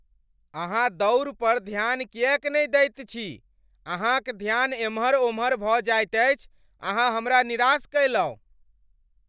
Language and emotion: Maithili, angry